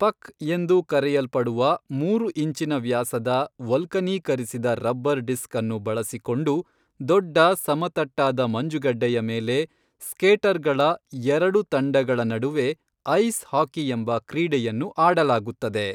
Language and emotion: Kannada, neutral